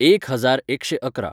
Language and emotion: Goan Konkani, neutral